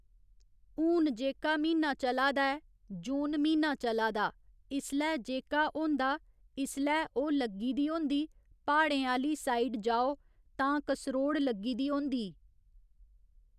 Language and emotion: Dogri, neutral